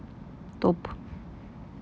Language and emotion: Russian, neutral